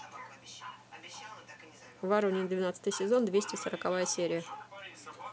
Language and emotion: Russian, neutral